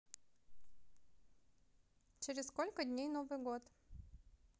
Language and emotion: Russian, neutral